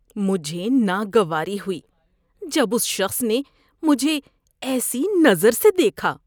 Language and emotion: Urdu, disgusted